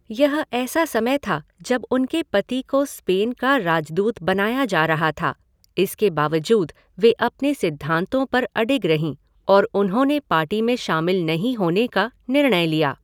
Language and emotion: Hindi, neutral